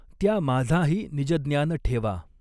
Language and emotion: Marathi, neutral